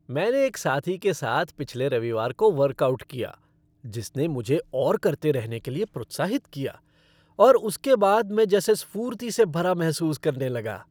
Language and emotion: Hindi, happy